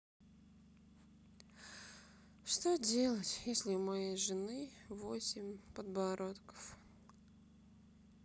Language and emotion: Russian, sad